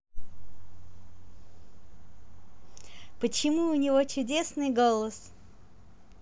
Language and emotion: Russian, positive